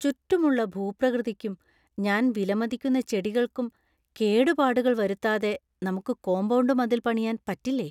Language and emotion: Malayalam, fearful